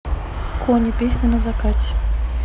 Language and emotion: Russian, neutral